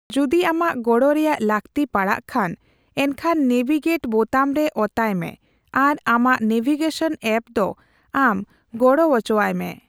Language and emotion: Santali, neutral